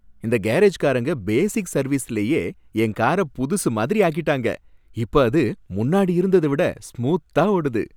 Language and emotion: Tamil, happy